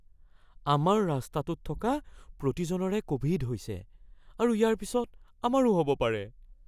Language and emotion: Assamese, fearful